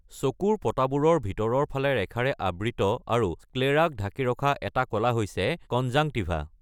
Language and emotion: Assamese, neutral